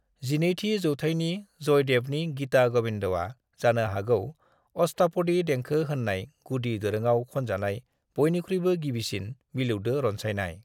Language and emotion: Bodo, neutral